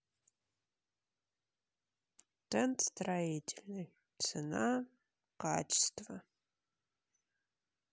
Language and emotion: Russian, sad